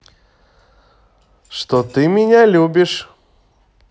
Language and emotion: Russian, positive